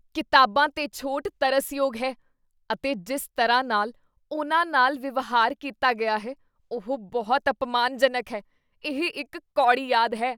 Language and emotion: Punjabi, disgusted